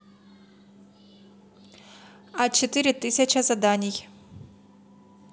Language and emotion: Russian, neutral